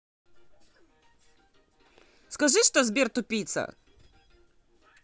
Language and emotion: Russian, angry